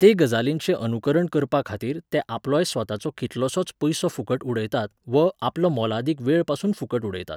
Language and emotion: Goan Konkani, neutral